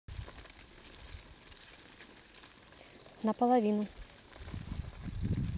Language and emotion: Russian, neutral